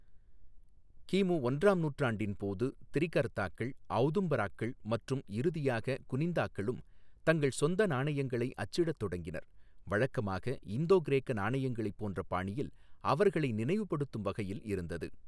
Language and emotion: Tamil, neutral